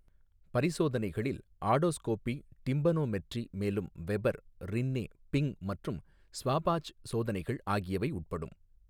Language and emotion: Tamil, neutral